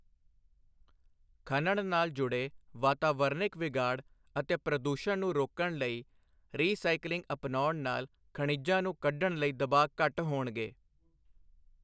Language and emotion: Punjabi, neutral